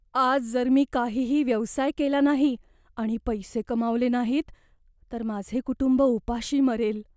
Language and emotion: Marathi, fearful